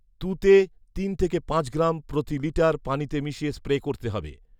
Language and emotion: Bengali, neutral